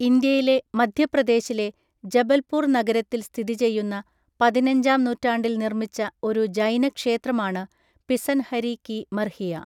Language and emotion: Malayalam, neutral